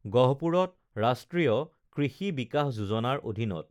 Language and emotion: Assamese, neutral